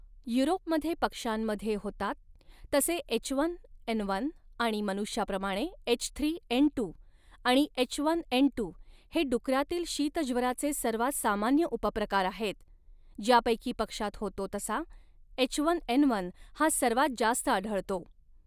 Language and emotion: Marathi, neutral